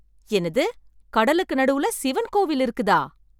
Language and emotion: Tamil, surprised